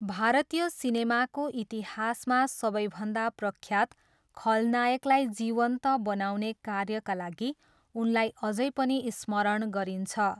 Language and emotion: Nepali, neutral